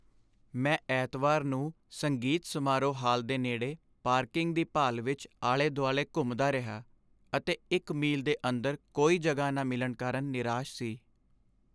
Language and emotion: Punjabi, sad